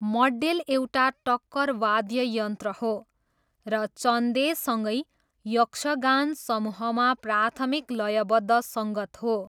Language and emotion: Nepali, neutral